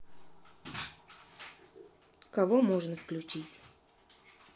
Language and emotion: Russian, neutral